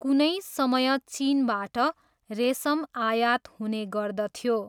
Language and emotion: Nepali, neutral